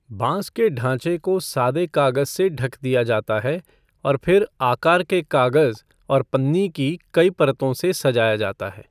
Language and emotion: Hindi, neutral